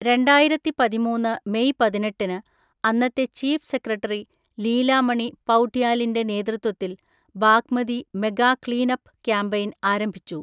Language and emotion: Malayalam, neutral